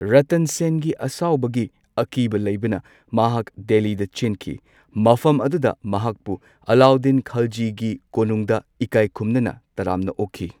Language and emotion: Manipuri, neutral